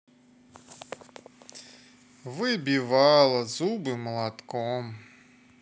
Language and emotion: Russian, sad